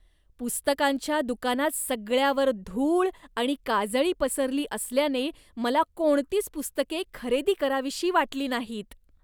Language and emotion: Marathi, disgusted